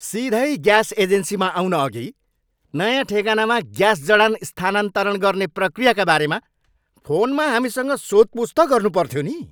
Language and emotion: Nepali, angry